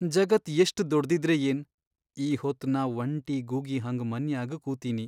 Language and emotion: Kannada, sad